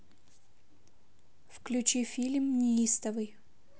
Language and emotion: Russian, neutral